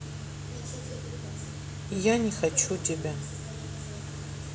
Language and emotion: Russian, sad